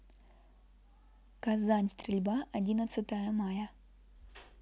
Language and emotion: Russian, neutral